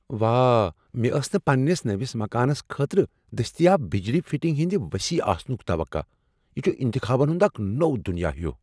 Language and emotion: Kashmiri, surprised